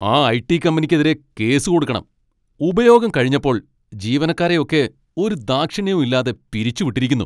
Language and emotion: Malayalam, angry